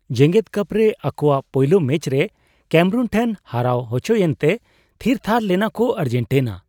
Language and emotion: Santali, surprised